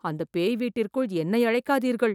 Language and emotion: Tamil, fearful